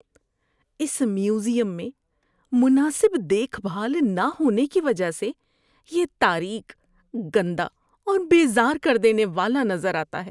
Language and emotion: Urdu, disgusted